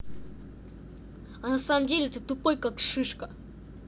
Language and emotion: Russian, angry